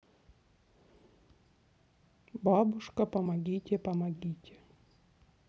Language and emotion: Russian, neutral